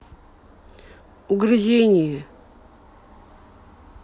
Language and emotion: Russian, neutral